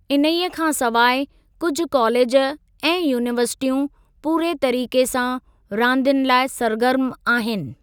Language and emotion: Sindhi, neutral